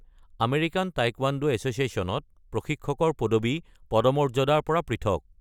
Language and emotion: Assamese, neutral